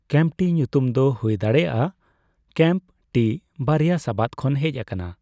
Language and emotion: Santali, neutral